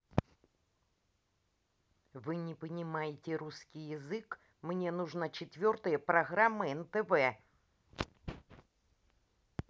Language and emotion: Russian, angry